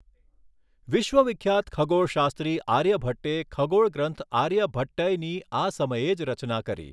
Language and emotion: Gujarati, neutral